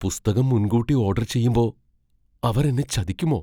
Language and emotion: Malayalam, fearful